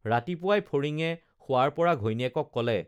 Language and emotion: Assamese, neutral